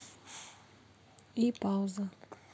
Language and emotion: Russian, neutral